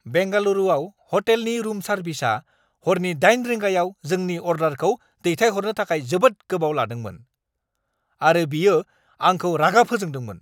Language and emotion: Bodo, angry